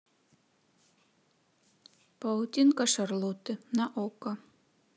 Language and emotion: Russian, neutral